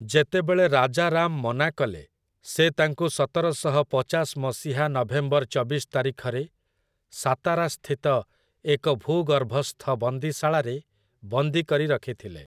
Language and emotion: Odia, neutral